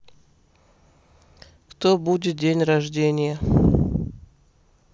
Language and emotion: Russian, neutral